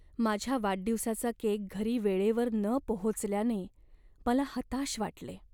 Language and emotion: Marathi, sad